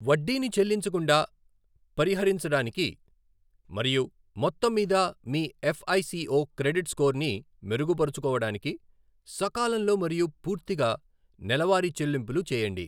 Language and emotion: Telugu, neutral